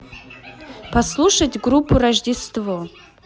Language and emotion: Russian, neutral